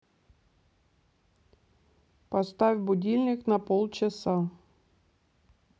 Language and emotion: Russian, neutral